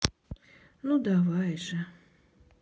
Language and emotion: Russian, sad